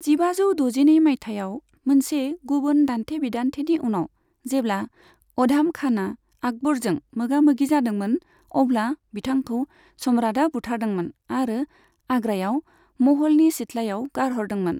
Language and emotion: Bodo, neutral